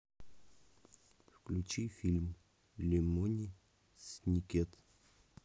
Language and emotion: Russian, neutral